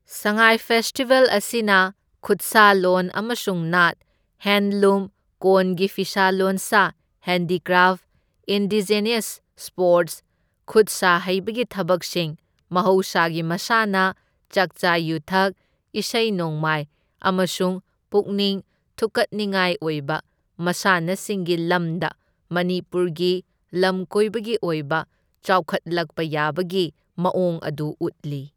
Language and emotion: Manipuri, neutral